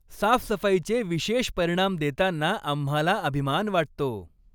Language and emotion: Marathi, happy